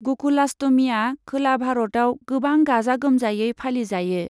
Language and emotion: Bodo, neutral